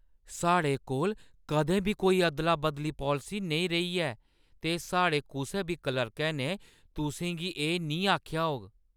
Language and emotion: Dogri, surprised